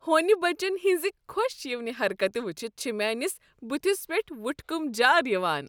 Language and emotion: Kashmiri, happy